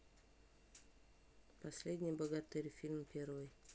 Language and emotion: Russian, neutral